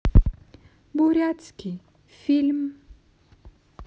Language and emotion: Russian, neutral